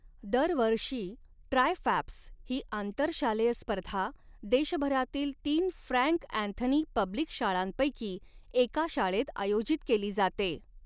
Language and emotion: Marathi, neutral